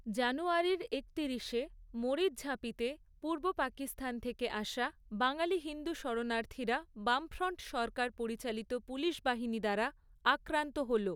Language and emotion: Bengali, neutral